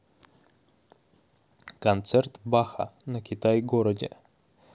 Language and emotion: Russian, neutral